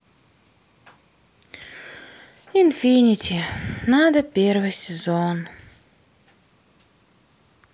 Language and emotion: Russian, sad